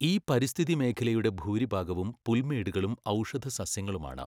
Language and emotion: Malayalam, neutral